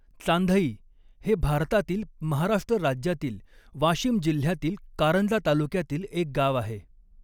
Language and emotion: Marathi, neutral